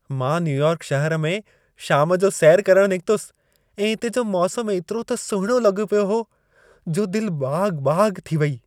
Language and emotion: Sindhi, happy